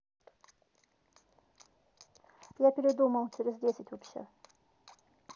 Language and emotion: Russian, neutral